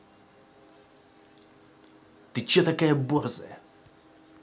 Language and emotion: Russian, angry